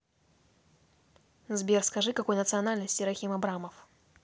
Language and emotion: Russian, neutral